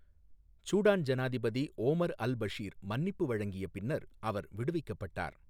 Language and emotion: Tamil, neutral